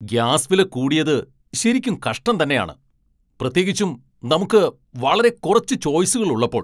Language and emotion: Malayalam, angry